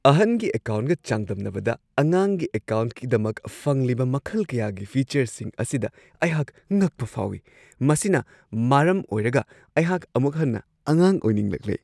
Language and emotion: Manipuri, surprised